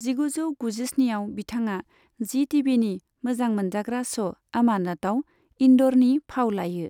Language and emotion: Bodo, neutral